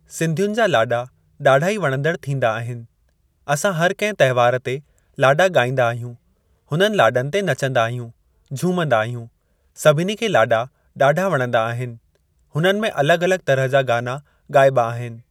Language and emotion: Sindhi, neutral